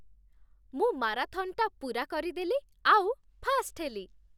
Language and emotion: Odia, happy